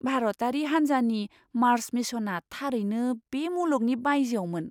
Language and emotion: Bodo, surprised